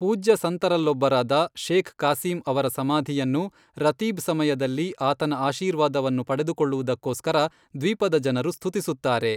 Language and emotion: Kannada, neutral